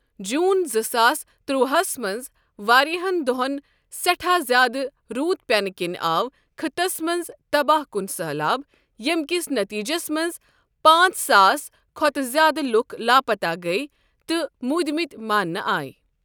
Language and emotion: Kashmiri, neutral